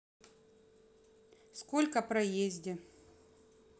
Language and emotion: Russian, neutral